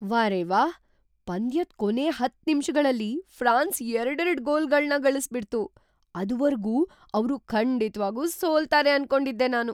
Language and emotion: Kannada, surprised